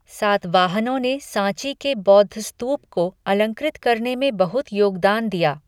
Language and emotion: Hindi, neutral